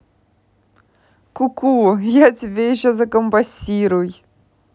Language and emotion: Russian, positive